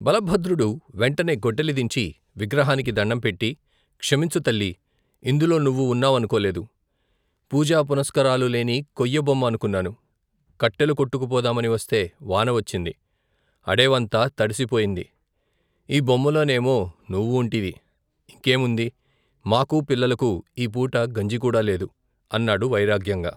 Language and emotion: Telugu, neutral